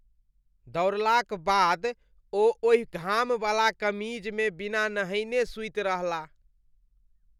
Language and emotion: Maithili, disgusted